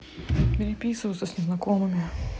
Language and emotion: Russian, neutral